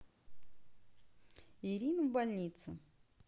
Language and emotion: Russian, neutral